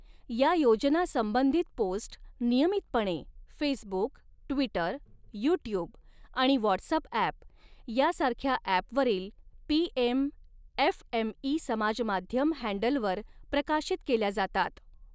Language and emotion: Marathi, neutral